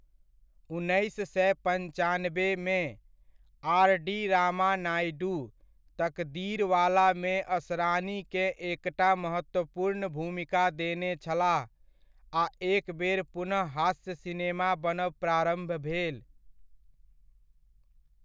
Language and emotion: Maithili, neutral